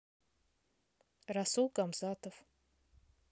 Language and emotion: Russian, neutral